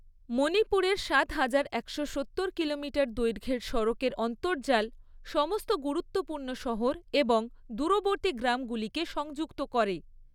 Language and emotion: Bengali, neutral